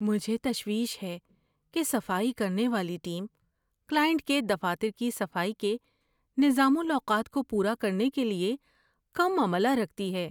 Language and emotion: Urdu, fearful